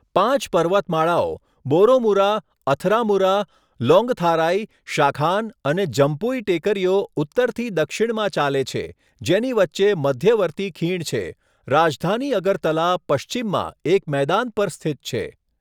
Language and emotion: Gujarati, neutral